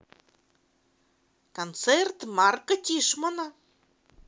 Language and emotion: Russian, positive